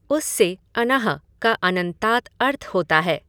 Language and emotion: Hindi, neutral